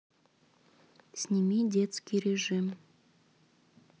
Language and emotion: Russian, neutral